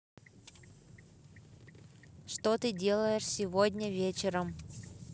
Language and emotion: Russian, neutral